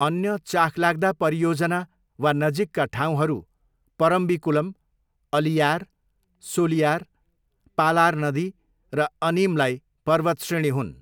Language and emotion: Nepali, neutral